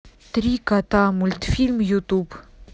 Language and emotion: Russian, neutral